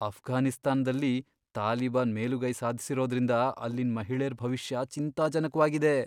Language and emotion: Kannada, fearful